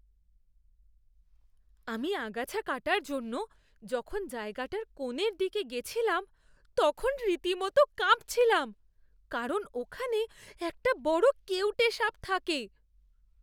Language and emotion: Bengali, fearful